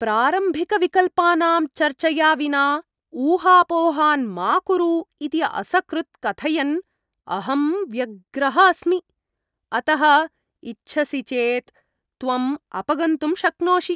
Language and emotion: Sanskrit, disgusted